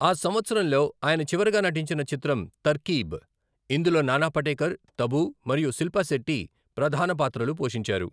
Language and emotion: Telugu, neutral